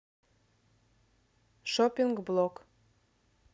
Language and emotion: Russian, neutral